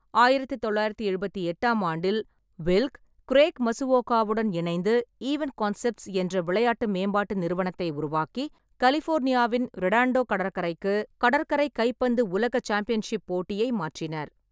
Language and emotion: Tamil, neutral